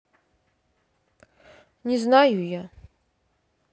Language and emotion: Russian, sad